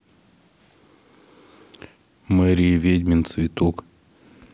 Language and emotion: Russian, neutral